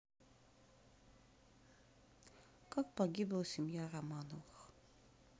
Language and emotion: Russian, sad